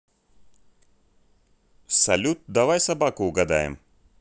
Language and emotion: Russian, positive